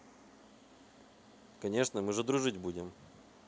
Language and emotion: Russian, neutral